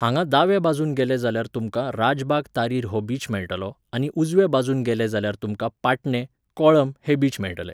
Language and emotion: Goan Konkani, neutral